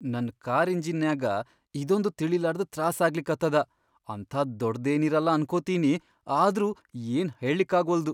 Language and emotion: Kannada, fearful